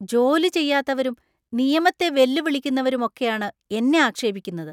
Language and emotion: Malayalam, disgusted